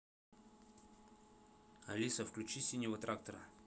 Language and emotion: Russian, neutral